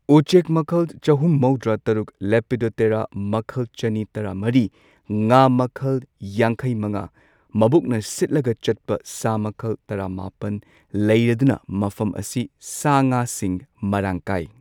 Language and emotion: Manipuri, neutral